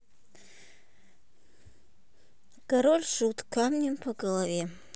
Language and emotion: Russian, neutral